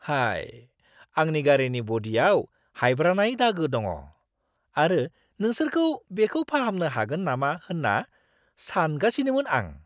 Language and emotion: Bodo, surprised